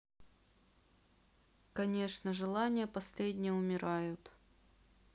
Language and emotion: Russian, sad